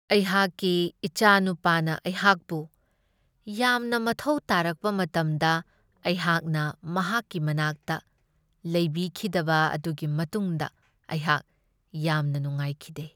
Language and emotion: Manipuri, sad